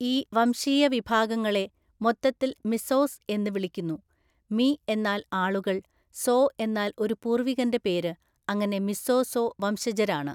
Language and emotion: Malayalam, neutral